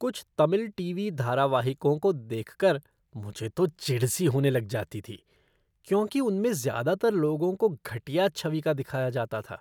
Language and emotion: Hindi, disgusted